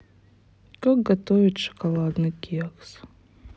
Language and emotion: Russian, sad